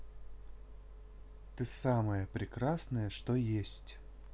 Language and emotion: Russian, neutral